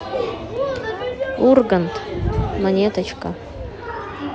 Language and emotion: Russian, neutral